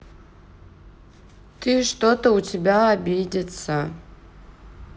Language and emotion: Russian, sad